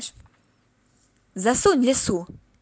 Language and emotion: Russian, positive